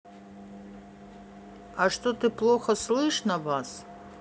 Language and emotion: Russian, neutral